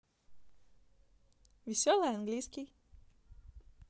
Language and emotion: Russian, positive